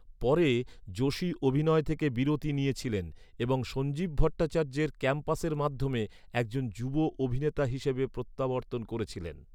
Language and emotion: Bengali, neutral